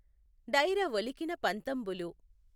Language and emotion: Telugu, neutral